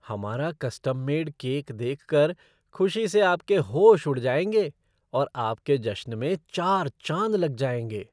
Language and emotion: Hindi, surprised